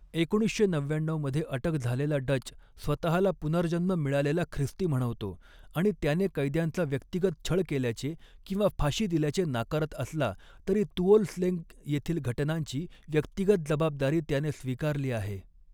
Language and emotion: Marathi, neutral